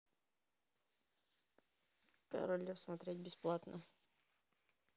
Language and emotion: Russian, neutral